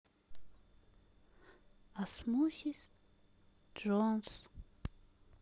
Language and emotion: Russian, sad